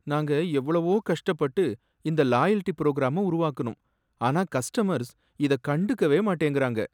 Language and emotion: Tamil, sad